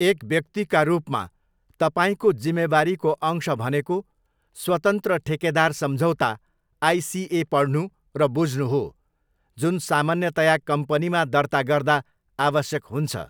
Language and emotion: Nepali, neutral